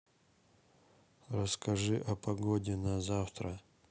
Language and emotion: Russian, sad